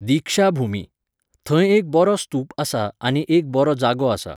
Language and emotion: Goan Konkani, neutral